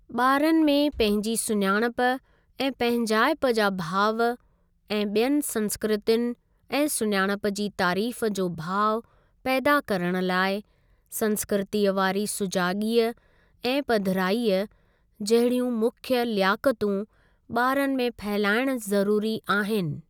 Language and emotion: Sindhi, neutral